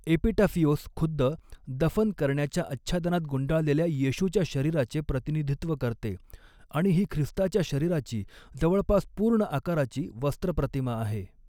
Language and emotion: Marathi, neutral